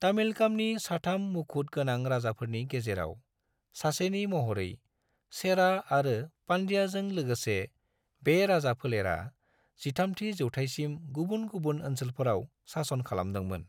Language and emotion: Bodo, neutral